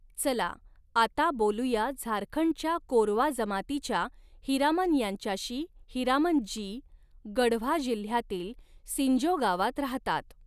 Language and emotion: Marathi, neutral